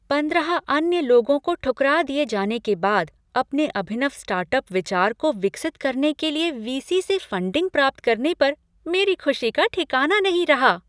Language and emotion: Hindi, happy